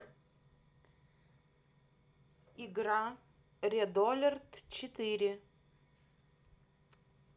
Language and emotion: Russian, neutral